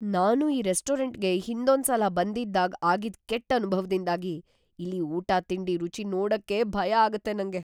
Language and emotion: Kannada, fearful